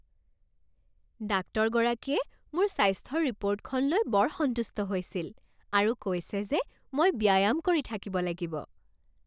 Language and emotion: Assamese, happy